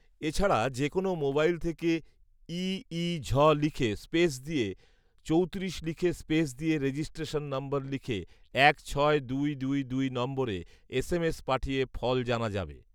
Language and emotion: Bengali, neutral